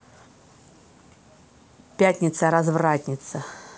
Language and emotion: Russian, neutral